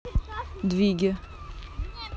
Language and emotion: Russian, neutral